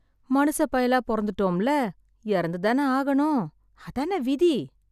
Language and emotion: Tamil, sad